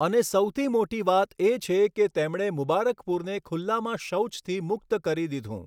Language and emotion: Gujarati, neutral